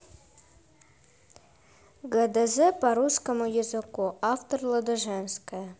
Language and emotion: Russian, neutral